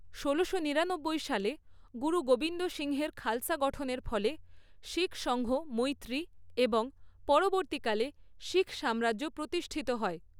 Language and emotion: Bengali, neutral